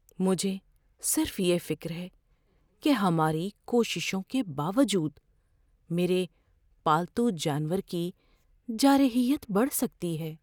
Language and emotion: Urdu, fearful